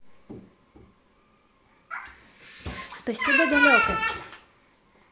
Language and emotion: Russian, neutral